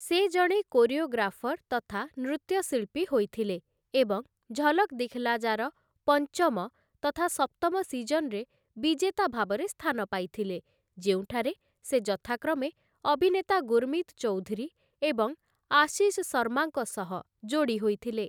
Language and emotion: Odia, neutral